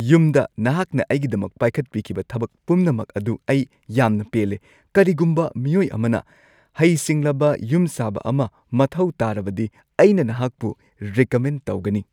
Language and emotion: Manipuri, happy